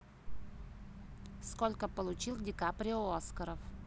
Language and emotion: Russian, neutral